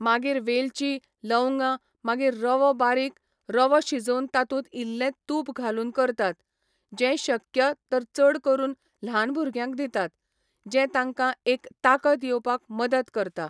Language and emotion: Goan Konkani, neutral